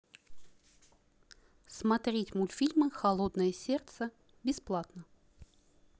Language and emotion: Russian, neutral